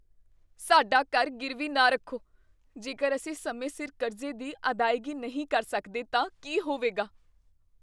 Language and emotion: Punjabi, fearful